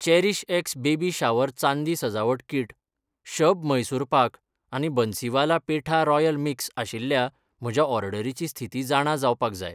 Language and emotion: Goan Konkani, neutral